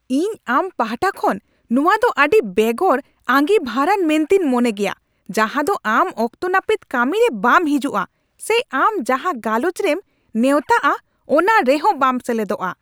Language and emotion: Santali, angry